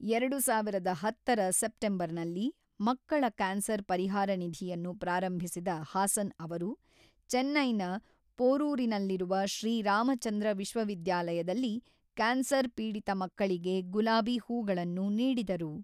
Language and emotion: Kannada, neutral